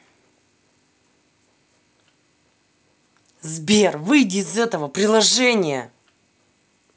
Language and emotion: Russian, angry